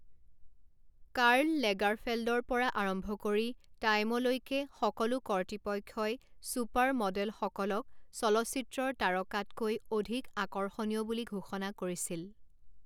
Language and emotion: Assamese, neutral